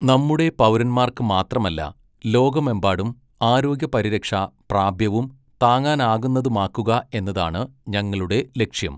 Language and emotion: Malayalam, neutral